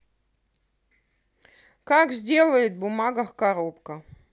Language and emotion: Russian, neutral